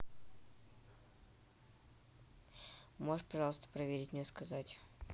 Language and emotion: Russian, neutral